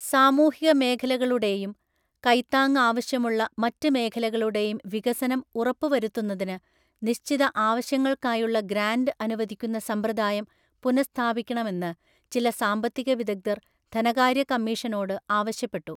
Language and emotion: Malayalam, neutral